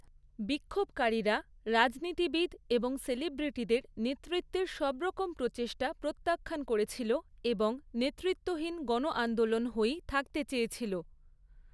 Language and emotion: Bengali, neutral